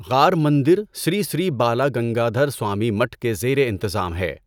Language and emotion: Urdu, neutral